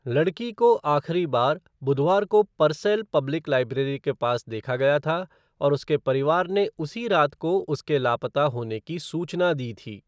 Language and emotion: Hindi, neutral